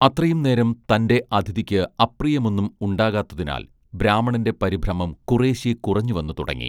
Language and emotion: Malayalam, neutral